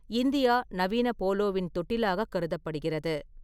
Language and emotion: Tamil, neutral